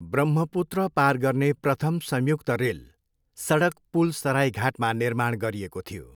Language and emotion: Nepali, neutral